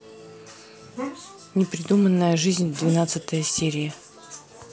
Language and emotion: Russian, neutral